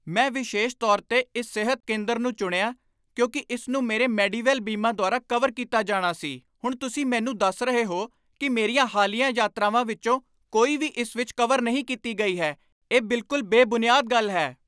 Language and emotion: Punjabi, angry